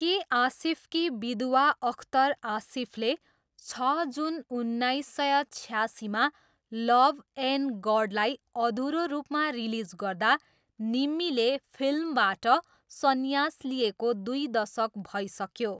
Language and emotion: Nepali, neutral